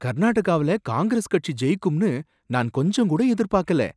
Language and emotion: Tamil, surprised